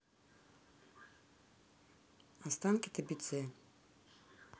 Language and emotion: Russian, neutral